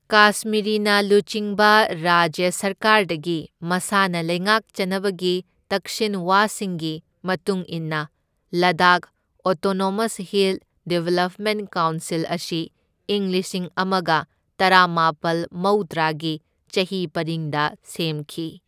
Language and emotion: Manipuri, neutral